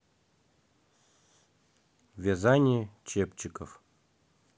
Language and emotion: Russian, neutral